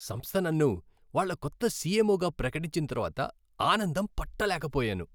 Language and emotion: Telugu, happy